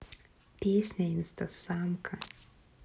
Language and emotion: Russian, neutral